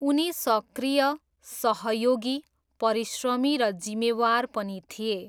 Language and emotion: Nepali, neutral